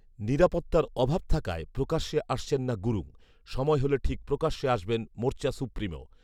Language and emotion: Bengali, neutral